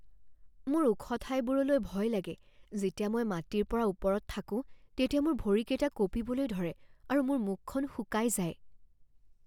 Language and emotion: Assamese, fearful